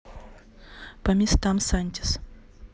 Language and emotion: Russian, neutral